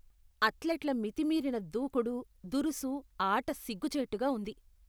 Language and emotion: Telugu, disgusted